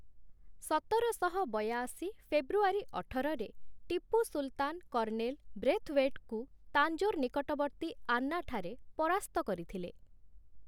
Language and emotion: Odia, neutral